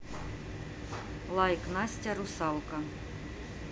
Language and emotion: Russian, neutral